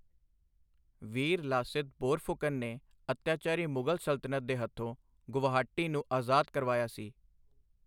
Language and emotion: Punjabi, neutral